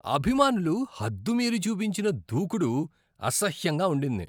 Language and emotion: Telugu, disgusted